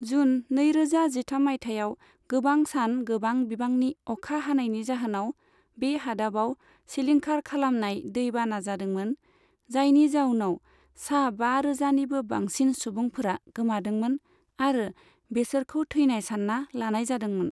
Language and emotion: Bodo, neutral